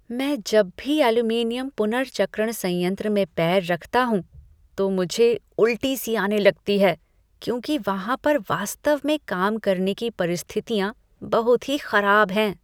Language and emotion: Hindi, disgusted